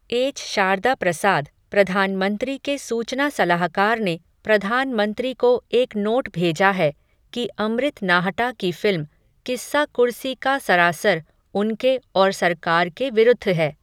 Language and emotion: Hindi, neutral